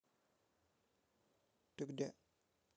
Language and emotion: Russian, neutral